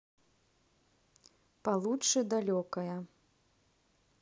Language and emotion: Russian, neutral